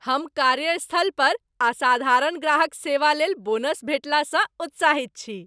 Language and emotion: Maithili, happy